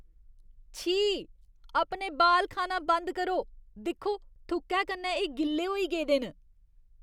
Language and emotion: Dogri, disgusted